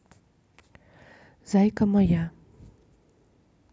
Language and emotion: Russian, neutral